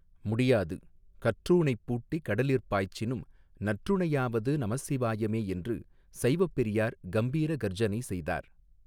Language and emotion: Tamil, neutral